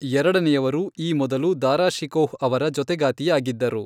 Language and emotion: Kannada, neutral